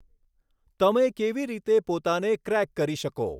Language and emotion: Gujarati, neutral